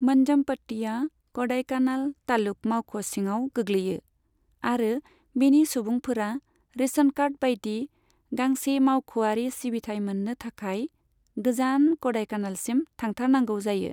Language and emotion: Bodo, neutral